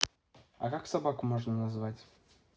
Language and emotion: Russian, neutral